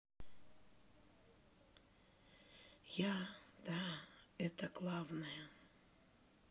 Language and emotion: Russian, sad